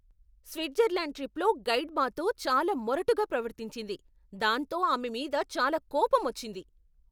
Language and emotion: Telugu, angry